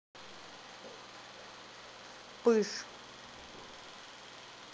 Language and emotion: Russian, neutral